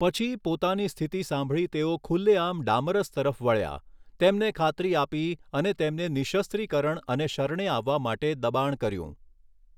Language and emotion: Gujarati, neutral